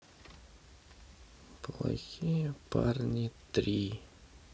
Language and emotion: Russian, sad